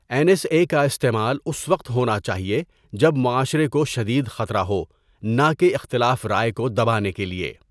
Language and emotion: Urdu, neutral